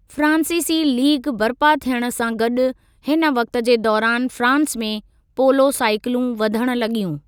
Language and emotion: Sindhi, neutral